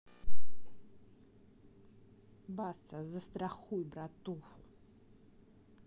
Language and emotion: Russian, angry